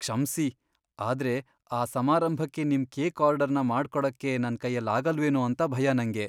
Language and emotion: Kannada, fearful